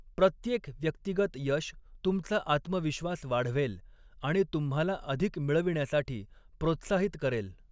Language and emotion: Marathi, neutral